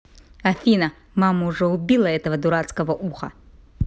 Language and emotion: Russian, neutral